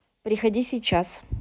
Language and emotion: Russian, neutral